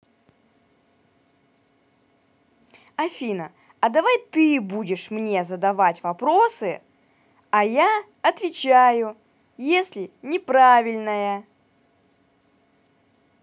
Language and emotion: Russian, angry